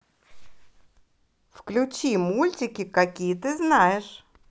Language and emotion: Russian, positive